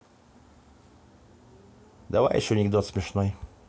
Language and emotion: Russian, neutral